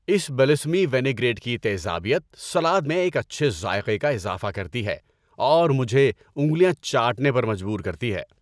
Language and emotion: Urdu, happy